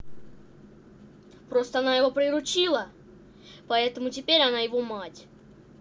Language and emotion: Russian, angry